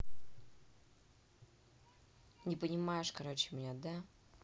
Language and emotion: Russian, angry